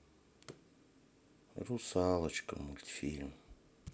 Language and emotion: Russian, sad